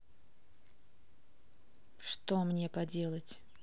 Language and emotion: Russian, neutral